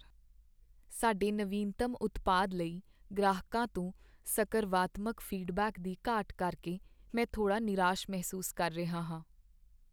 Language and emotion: Punjabi, sad